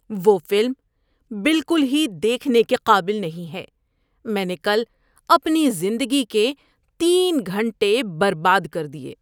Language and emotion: Urdu, disgusted